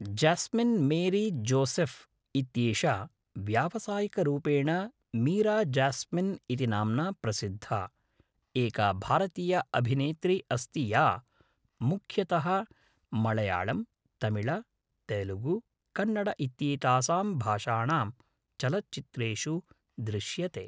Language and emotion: Sanskrit, neutral